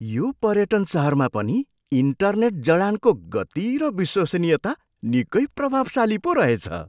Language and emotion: Nepali, surprised